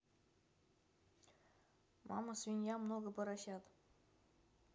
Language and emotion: Russian, neutral